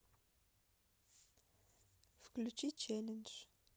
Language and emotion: Russian, neutral